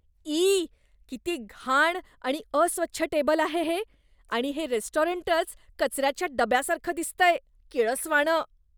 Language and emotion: Marathi, disgusted